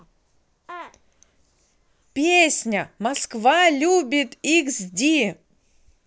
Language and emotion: Russian, positive